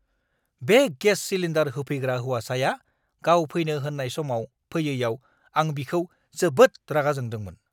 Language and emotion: Bodo, angry